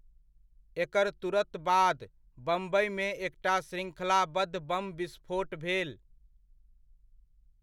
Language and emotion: Maithili, neutral